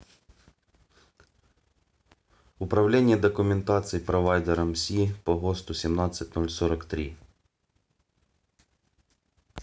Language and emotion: Russian, neutral